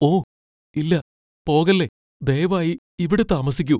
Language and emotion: Malayalam, fearful